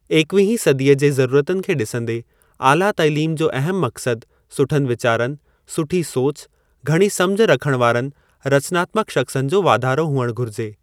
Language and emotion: Sindhi, neutral